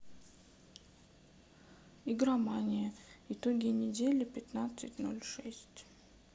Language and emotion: Russian, sad